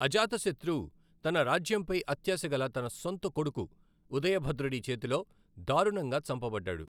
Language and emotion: Telugu, neutral